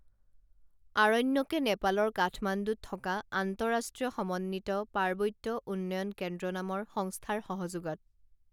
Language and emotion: Assamese, neutral